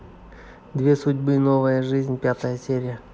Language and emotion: Russian, neutral